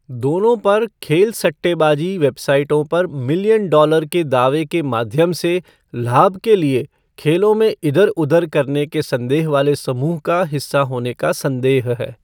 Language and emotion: Hindi, neutral